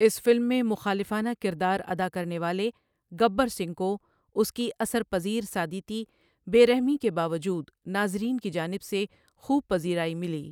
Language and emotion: Urdu, neutral